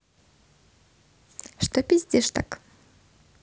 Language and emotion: Russian, neutral